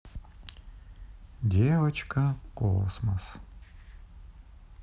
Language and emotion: Russian, neutral